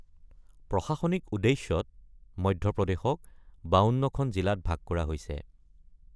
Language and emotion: Assamese, neutral